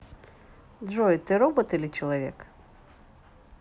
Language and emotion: Russian, neutral